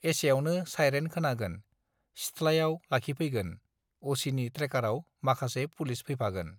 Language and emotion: Bodo, neutral